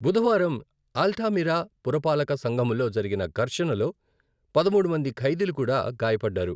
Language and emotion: Telugu, neutral